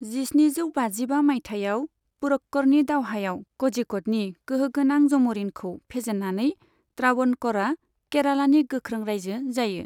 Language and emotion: Bodo, neutral